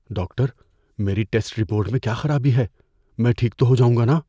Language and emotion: Urdu, fearful